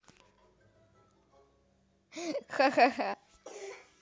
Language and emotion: Russian, positive